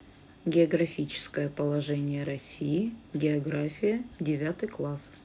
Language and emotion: Russian, neutral